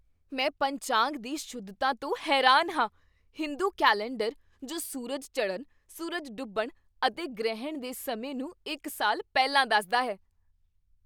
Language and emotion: Punjabi, surprised